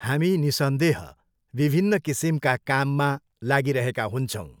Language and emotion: Nepali, neutral